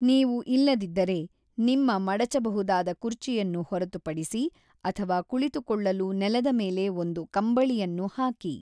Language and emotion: Kannada, neutral